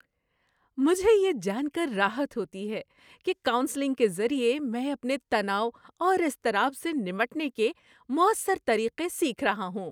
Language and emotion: Urdu, happy